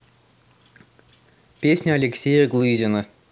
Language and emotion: Russian, neutral